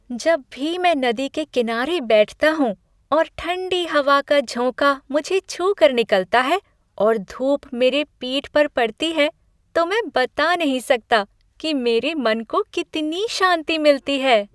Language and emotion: Hindi, happy